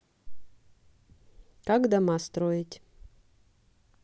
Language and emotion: Russian, neutral